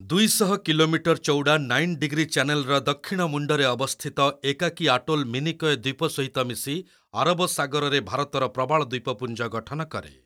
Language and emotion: Odia, neutral